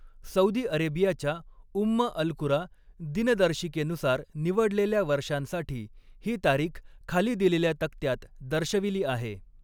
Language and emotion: Marathi, neutral